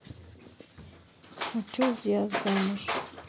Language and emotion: Russian, neutral